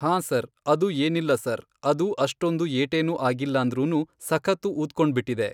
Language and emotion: Kannada, neutral